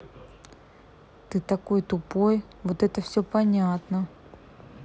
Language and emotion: Russian, angry